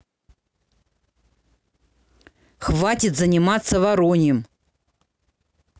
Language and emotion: Russian, angry